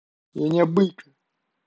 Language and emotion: Russian, angry